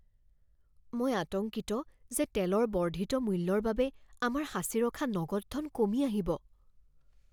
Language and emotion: Assamese, fearful